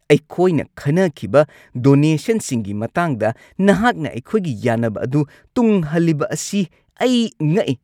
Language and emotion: Manipuri, angry